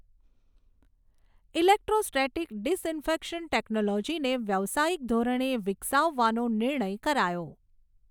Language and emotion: Gujarati, neutral